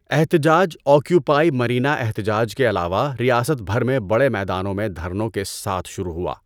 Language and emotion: Urdu, neutral